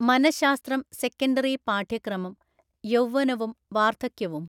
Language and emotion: Malayalam, neutral